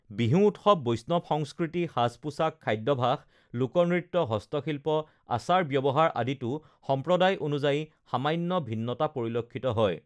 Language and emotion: Assamese, neutral